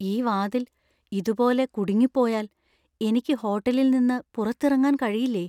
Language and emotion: Malayalam, fearful